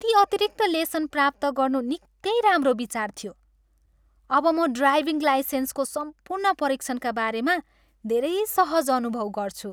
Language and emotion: Nepali, happy